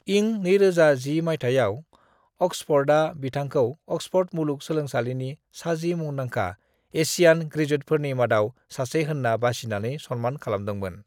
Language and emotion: Bodo, neutral